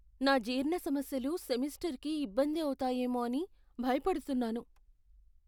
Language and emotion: Telugu, fearful